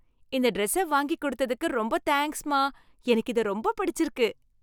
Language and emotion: Tamil, happy